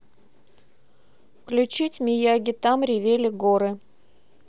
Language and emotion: Russian, neutral